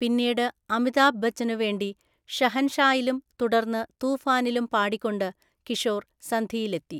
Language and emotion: Malayalam, neutral